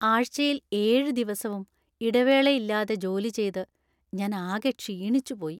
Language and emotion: Malayalam, sad